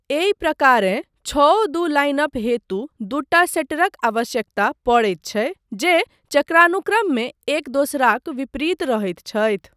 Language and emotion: Maithili, neutral